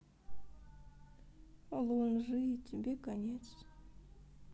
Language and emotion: Russian, sad